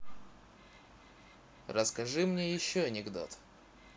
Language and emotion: Russian, neutral